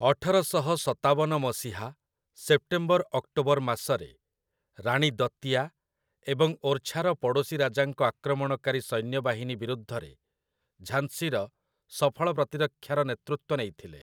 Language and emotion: Odia, neutral